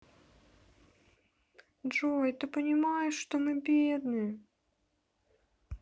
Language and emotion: Russian, sad